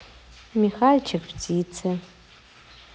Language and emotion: Russian, neutral